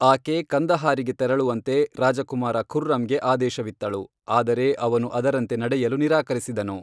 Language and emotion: Kannada, neutral